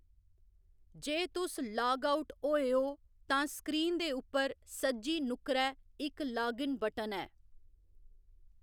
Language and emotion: Dogri, neutral